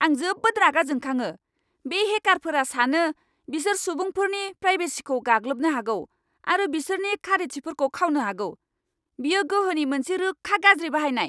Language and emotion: Bodo, angry